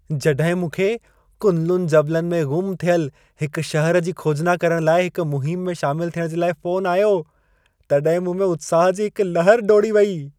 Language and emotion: Sindhi, happy